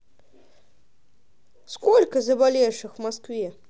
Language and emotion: Russian, positive